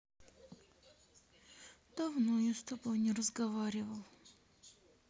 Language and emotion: Russian, sad